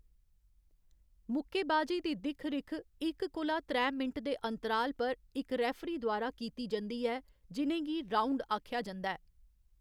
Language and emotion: Dogri, neutral